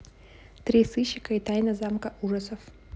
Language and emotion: Russian, neutral